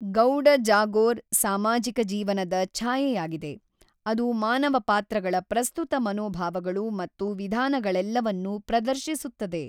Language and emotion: Kannada, neutral